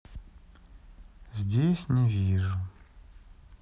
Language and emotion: Russian, sad